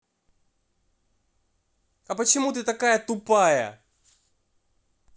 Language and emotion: Russian, angry